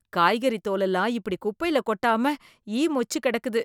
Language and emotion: Tamil, disgusted